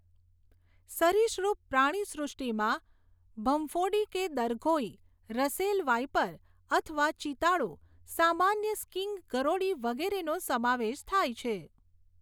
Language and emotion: Gujarati, neutral